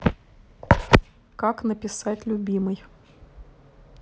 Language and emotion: Russian, neutral